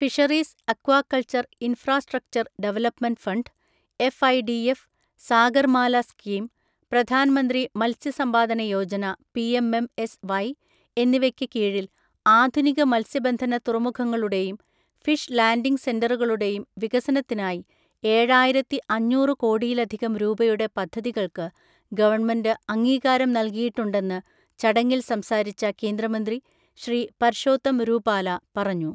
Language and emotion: Malayalam, neutral